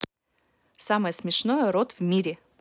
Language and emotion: Russian, neutral